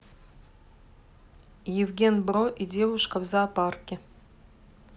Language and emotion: Russian, neutral